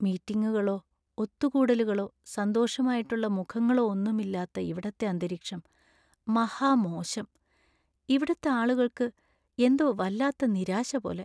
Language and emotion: Malayalam, sad